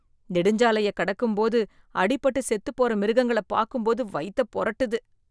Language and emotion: Tamil, disgusted